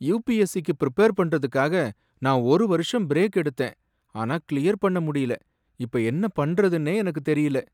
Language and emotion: Tamil, sad